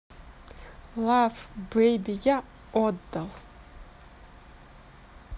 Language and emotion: Russian, neutral